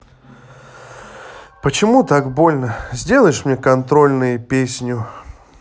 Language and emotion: Russian, sad